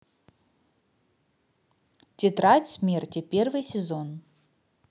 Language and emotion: Russian, neutral